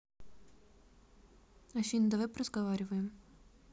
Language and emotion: Russian, neutral